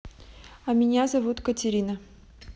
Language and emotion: Russian, neutral